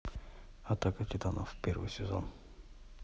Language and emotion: Russian, neutral